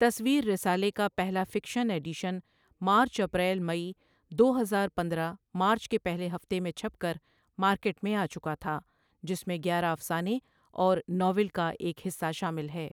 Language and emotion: Urdu, neutral